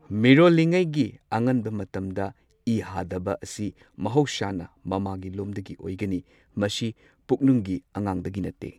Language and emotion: Manipuri, neutral